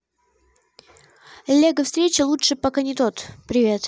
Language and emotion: Russian, neutral